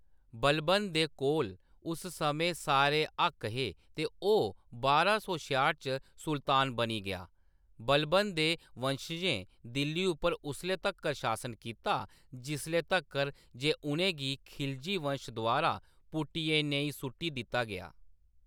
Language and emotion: Dogri, neutral